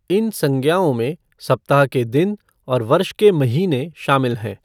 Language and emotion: Hindi, neutral